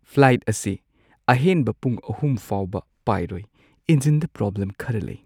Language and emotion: Manipuri, sad